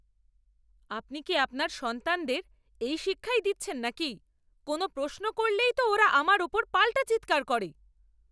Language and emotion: Bengali, angry